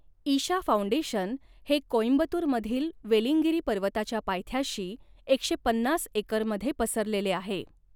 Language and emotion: Marathi, neutral